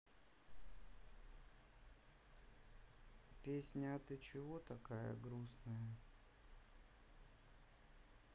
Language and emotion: Russian, sad